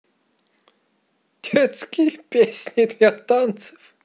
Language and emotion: Russian, positive